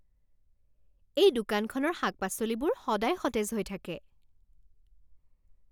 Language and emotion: Assamese, happy